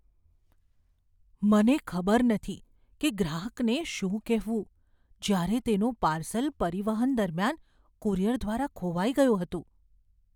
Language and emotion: Gujarati, fearful